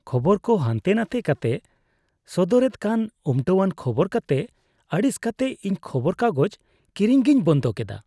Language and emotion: Santali, disgusted